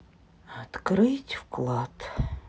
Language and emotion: Russian, sad